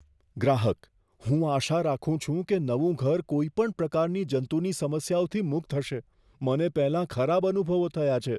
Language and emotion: Gujarati, fearful